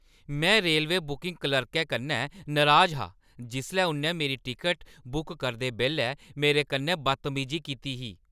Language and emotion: Dogri, angry